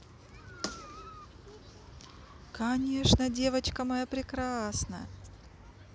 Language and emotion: Russian, positive